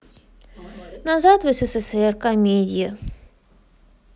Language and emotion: Russian, sad